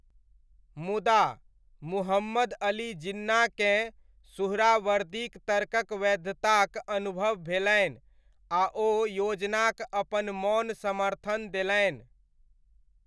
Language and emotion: Maithili, neutral